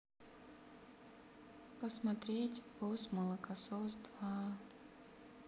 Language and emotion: Russian, sad